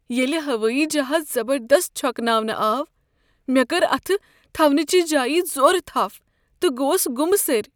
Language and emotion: Kashmiri, fearful